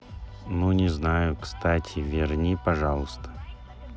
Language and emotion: Russian, neutral